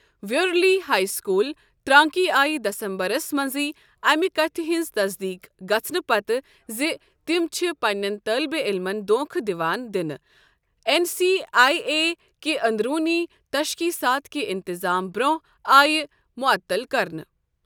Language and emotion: Kashmiri, neutral